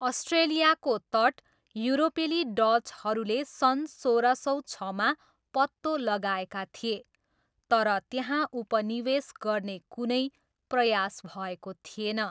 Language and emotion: Nepali, neutral